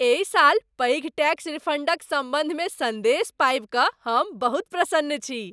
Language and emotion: Maithili, happy